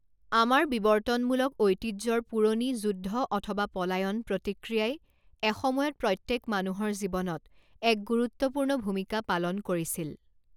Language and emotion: Assamese, neutral